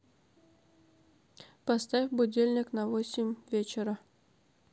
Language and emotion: Russian, neutral